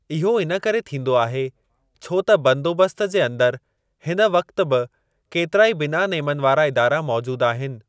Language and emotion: Sindhi, neutral